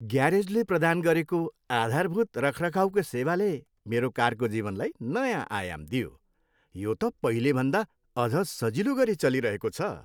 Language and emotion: Nepali, happy